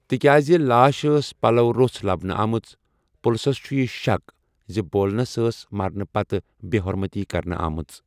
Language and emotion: Kashmiri, neutral